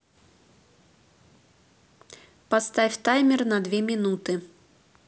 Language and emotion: Russian, neutral